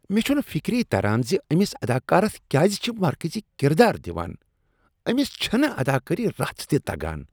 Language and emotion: Kashmiri, disgusted